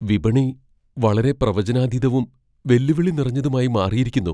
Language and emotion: Malayalam, fearful